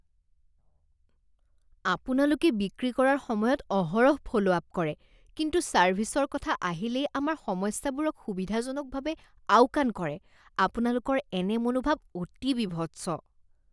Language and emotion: Assamese, disgusted